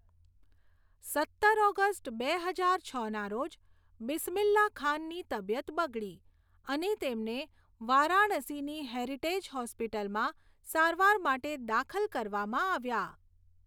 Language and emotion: Gujarati, neutral